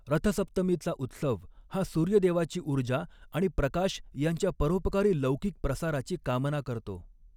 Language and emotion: Marathi, neutral